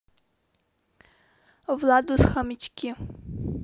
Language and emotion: Russian, neutral